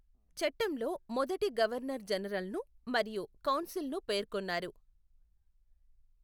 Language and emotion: Telugu, neutral